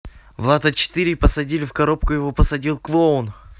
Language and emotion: Russian, neutral